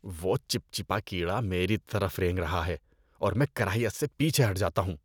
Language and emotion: Urdu, disgusted